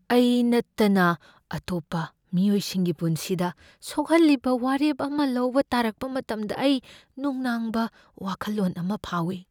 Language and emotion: Manipuri, fearful